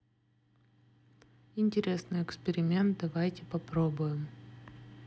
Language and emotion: Russian, neutral